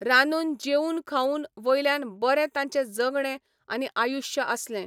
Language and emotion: Goan Konkani, neutral